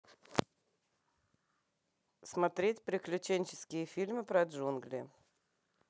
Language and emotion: Russian, neutral